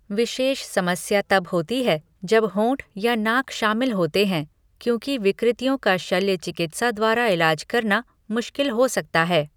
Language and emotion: Hindi, neutral